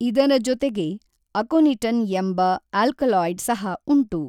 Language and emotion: Kannada, neutral